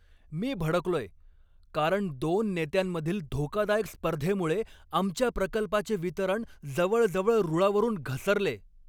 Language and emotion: Marathi, angry